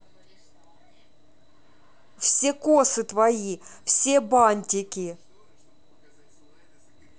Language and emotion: Russian, neutral